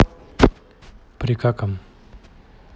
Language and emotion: Russian, neutral